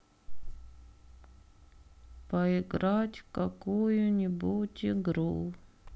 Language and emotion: Russian, sad